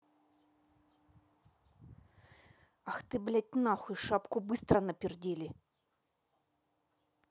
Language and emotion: Russian, angry